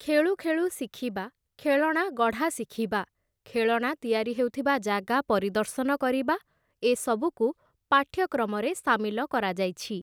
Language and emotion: Odia, neutral